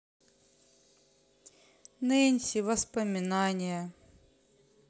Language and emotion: Russian, sad